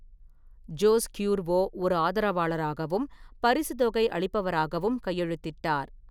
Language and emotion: Tamil, neutral